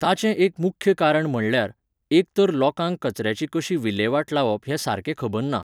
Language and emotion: Goan Konkani, neutral